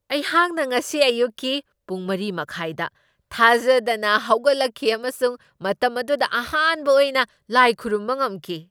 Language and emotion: Manipuri, surprised